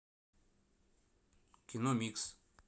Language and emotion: Russian, neutral